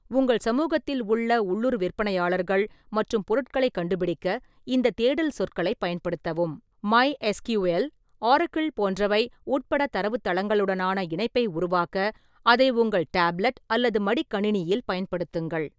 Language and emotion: Tamil, neutral